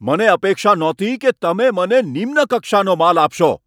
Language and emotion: Gujarati, angry